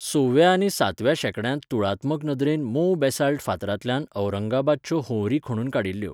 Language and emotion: Goan Konkani, neutral